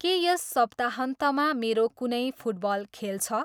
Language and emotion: Nepali, neutral